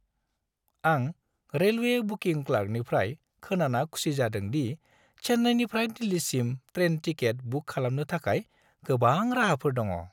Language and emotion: Bodo, happy